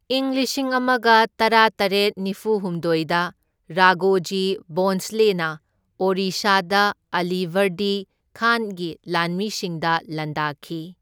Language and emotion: Manipuri, neutral